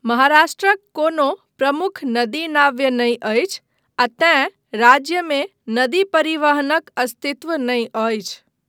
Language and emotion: Maithili, neutral